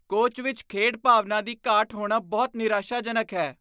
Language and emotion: Punjabi, disgusted